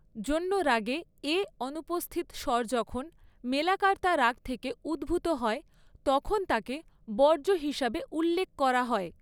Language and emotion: Bengali, neutral